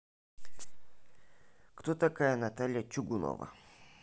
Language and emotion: Russian, neutral